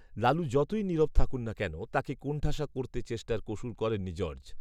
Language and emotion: Bengali, neutral